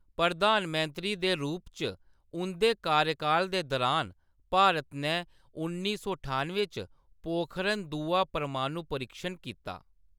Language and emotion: Dogri, neutral